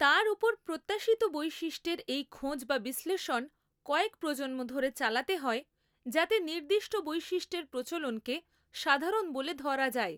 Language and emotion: Bengali, neutral